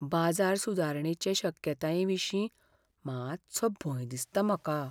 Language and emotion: Goan Konkani, fearful